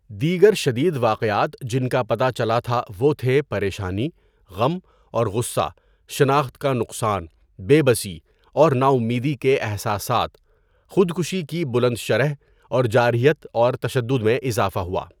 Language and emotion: Urdu, neutral